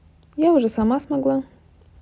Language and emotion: Russian, positive